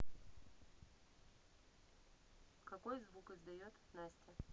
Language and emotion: Russian, neutral